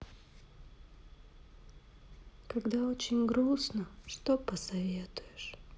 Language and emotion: Russian, sad